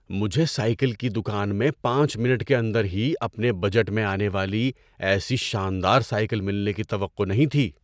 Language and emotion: Urdu, surprised